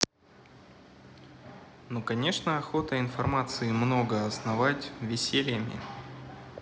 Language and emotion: Russian, neutral